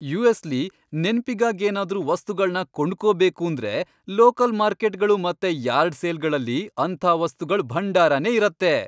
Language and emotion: Kannada, happy